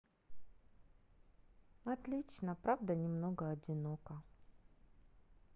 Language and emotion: Russian, sad